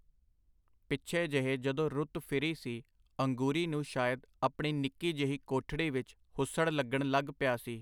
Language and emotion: Punjabi, neutral